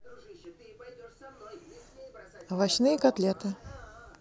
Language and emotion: Russian, neutral